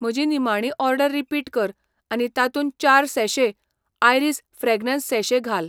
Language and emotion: Goan Konkani, neutral